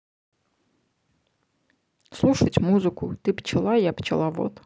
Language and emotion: Russian, neutral